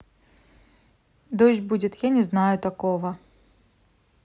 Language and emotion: Russian, neutral